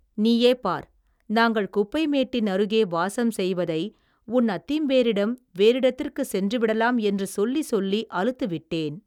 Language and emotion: Tamil, neutral